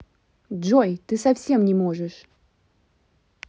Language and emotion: Russian, neutral